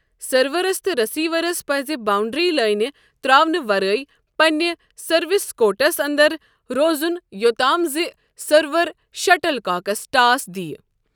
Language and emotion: Kashmiri, neutral